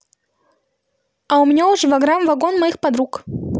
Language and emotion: Russian, positive